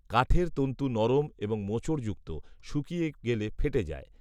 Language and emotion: Bengali, neutral